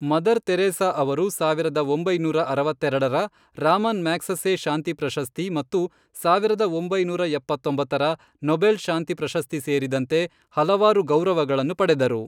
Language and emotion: Kannada, neutral